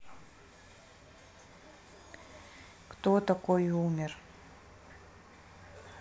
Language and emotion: Russian, neutral